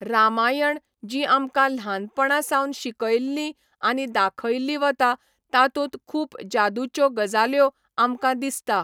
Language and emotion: Goan Konkani, neutral